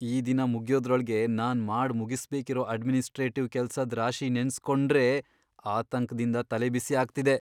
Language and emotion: Kannada, fearful